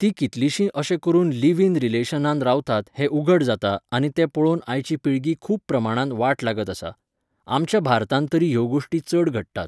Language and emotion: Goan Konkani, neutral